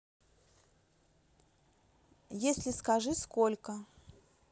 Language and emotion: Russian, neutral